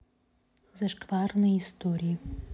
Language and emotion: Russian, neutral